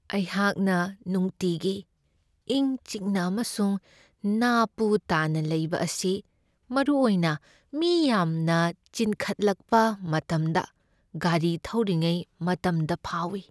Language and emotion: Manipuri, sad